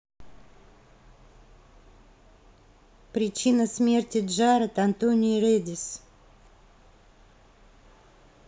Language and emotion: Russian, neutral